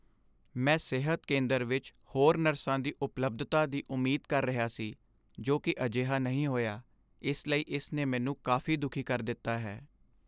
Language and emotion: Punjabi, sad